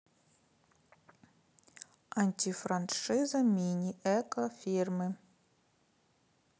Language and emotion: Russian, neutral